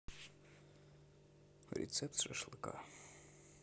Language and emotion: Russian, neutral